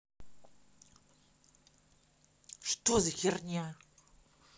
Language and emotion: Russian, angry